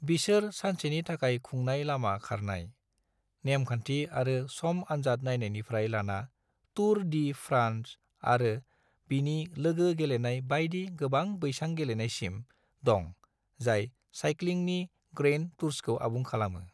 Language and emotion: Bodo, neutral